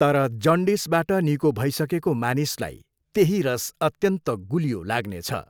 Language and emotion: Nepali, neutral